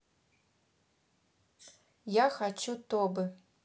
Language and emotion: Russian, neutral